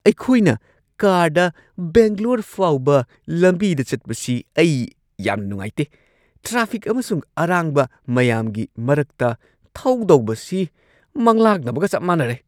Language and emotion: Manipuri, angry